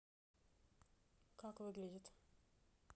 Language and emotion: Russian, neutral